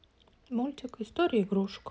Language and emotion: Russian, sad